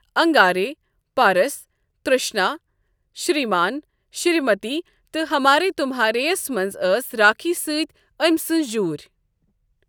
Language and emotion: Kashmiri, neutral